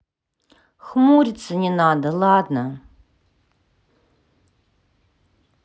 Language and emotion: Russian, sad